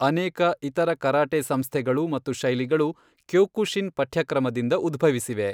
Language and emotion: Kannada, neutral